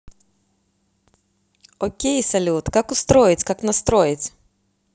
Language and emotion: Russian, positive